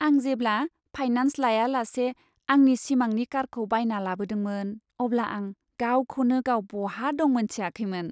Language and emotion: Bodo, happy